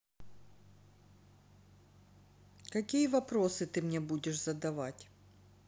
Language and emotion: Russian, neutral